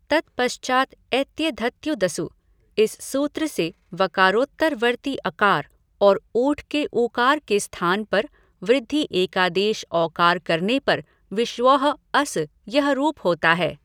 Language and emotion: Hindi, neutral